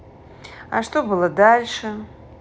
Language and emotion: Russian, neutral